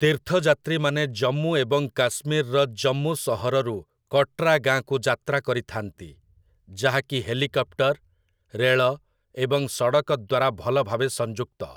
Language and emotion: Odia, neutral